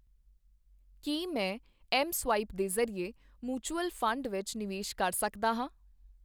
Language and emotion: Punjabi, neutral